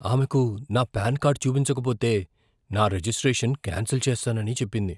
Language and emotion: Telugu, fearful